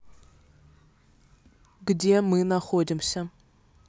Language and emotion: Russian, neutral